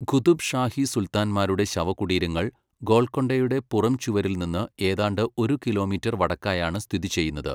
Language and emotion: Malayalam, neutral